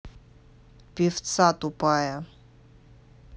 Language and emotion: Russian, angry